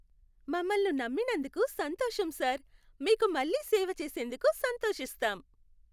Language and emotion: Telugu, happy